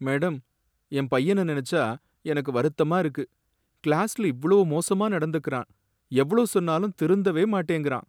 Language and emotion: Tamil, sad